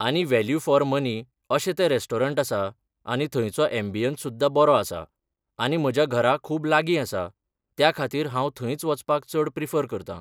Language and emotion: Goan Konkani, neutral